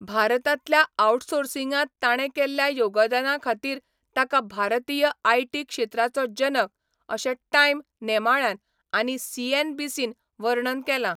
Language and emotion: Goan Konkani, neutral